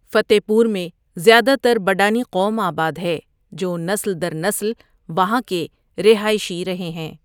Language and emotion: Urdu, neutral